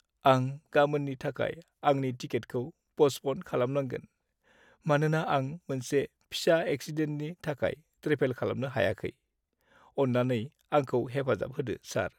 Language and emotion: Bodo, sad